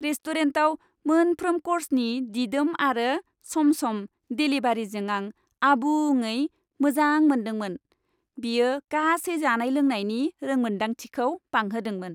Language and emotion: Bodo, happy